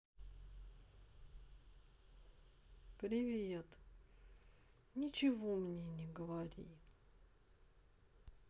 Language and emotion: Russian, sad